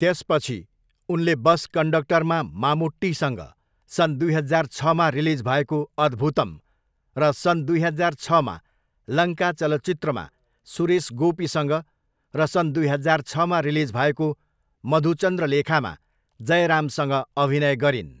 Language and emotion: Nepali, neutral